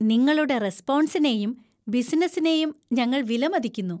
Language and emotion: Malayalam, happy